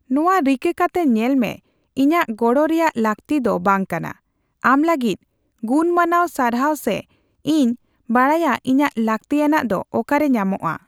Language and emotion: Santali, neutral